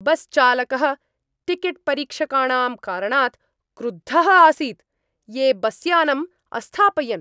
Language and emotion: Sanskrit, angry